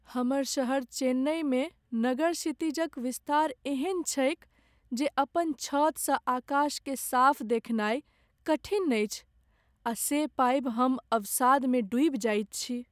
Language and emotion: Maithili, sad